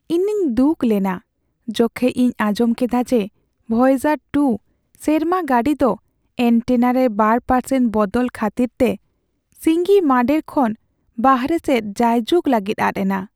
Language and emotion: Santali, sad